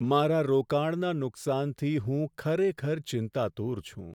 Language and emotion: Gujarati, sad